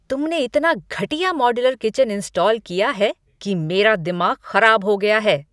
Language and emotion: Hindi, angry